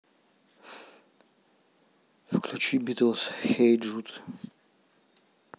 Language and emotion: Russian, neutral